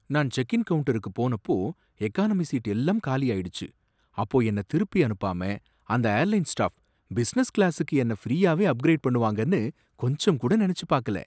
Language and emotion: Tamil, surprised